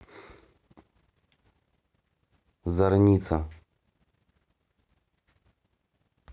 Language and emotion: Russian, neutral